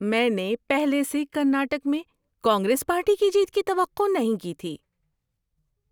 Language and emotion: Urdu, surprised